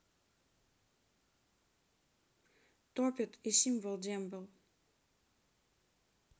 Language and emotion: Russian, neutral